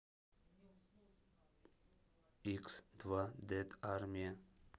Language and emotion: Russian, neutral